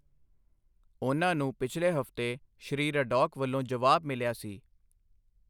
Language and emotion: Punjabi, neutral